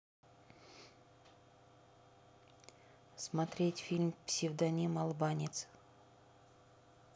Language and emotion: Russian, neutral